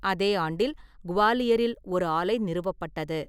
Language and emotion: Tamil, neutral